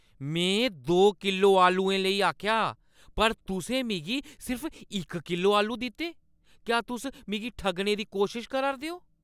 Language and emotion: Dogri, angry